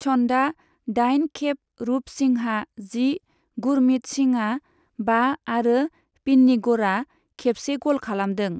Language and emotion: Bodo, neutral